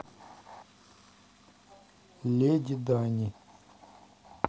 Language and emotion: Russian, neutral